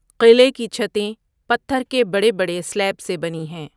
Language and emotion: Urdu, neutral